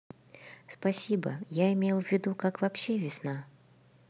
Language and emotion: Russian, neutral